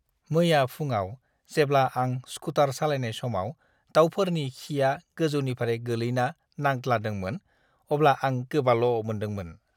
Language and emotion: Bodo, disgusted